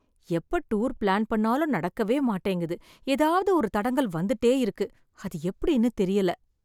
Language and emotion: Tamil, sad